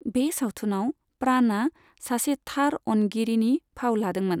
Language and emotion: Bodo, neutral